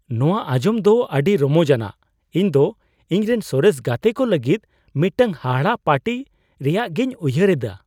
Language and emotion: Santali, surprised